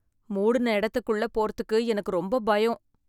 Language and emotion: Tamil, fearful